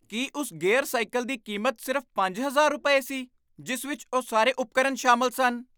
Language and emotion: Punjabi, surprised